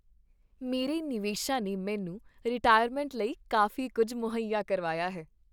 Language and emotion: Punjabi, happy